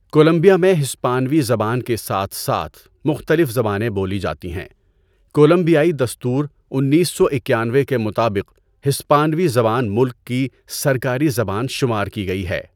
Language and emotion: Urdu, neutral